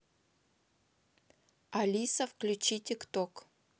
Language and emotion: Russian, neutral